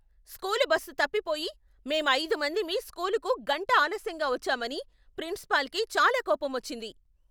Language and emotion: Telugu, angry